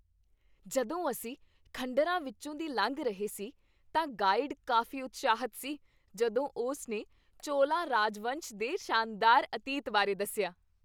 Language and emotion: Punjabi, happy